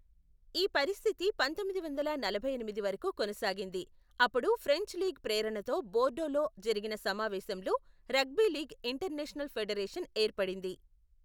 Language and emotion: Telugu, neutral